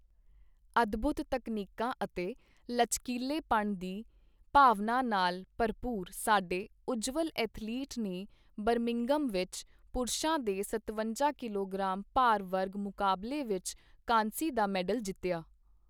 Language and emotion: Punjabi, neutral